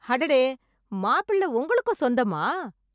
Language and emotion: Tamil, surprised